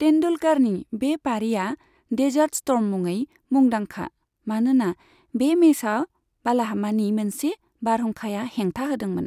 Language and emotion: Bodo, neutral